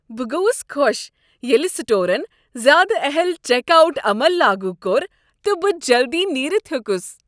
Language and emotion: Kashmiri, happy